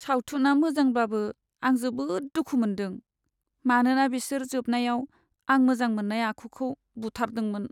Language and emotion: Bodo, sad